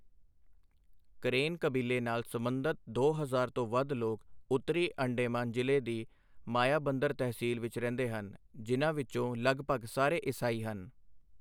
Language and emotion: Punjabi, neutral